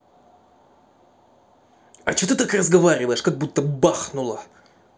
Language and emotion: Russian, angry